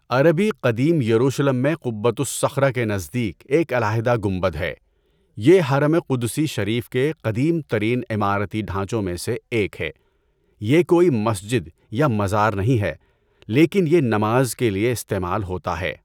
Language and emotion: Urdu, neutral